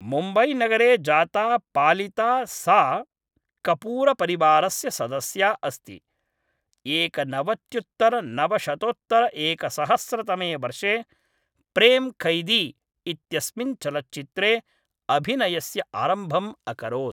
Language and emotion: Sanskrit, neutral